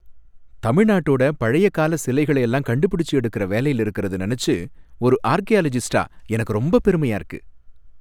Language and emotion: Tamil, happy